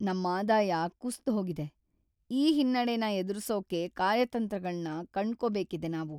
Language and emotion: Kannada, sad